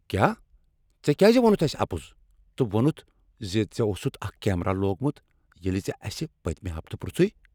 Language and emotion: Kashmiri, angry